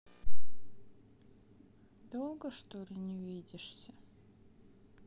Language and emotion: Russian, sad